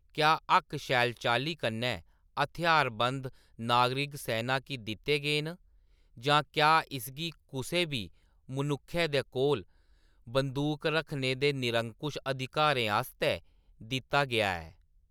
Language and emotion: Dogri, neutral